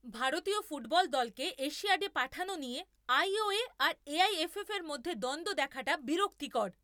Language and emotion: Bengali, angry